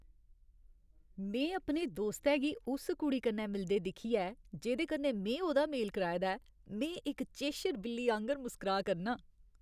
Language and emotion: Dogri, happy